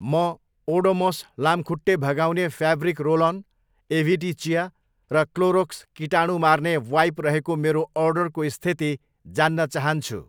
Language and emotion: Nepali, neutral